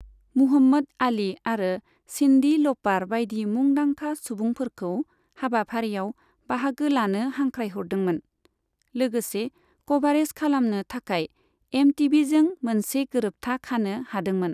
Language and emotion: Bodo, neutral